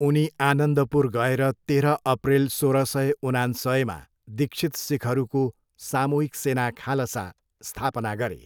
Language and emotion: Nepali, neutral